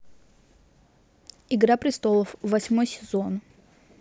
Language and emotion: Russian, neutral